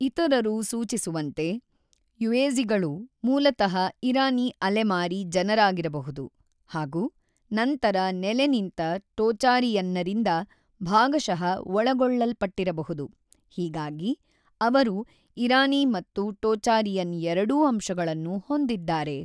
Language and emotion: Kannada, neutral